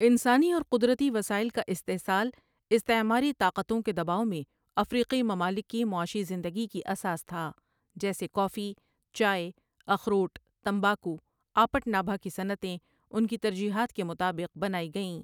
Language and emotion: Urdu, neutral